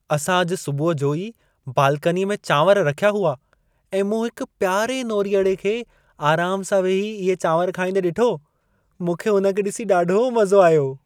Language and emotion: Sindhi, happy